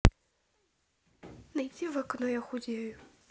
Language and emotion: Russian, neutral